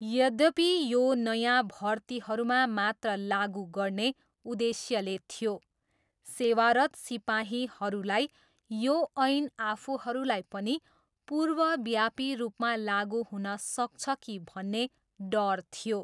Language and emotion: Nepali, neutral